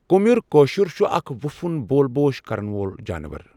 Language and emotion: Kashmiri, neutral